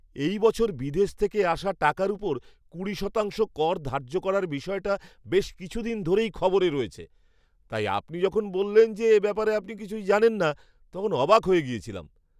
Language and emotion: Bengali, surprised